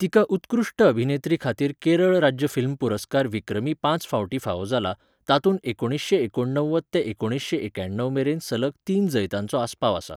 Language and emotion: Goan Konkani, neutral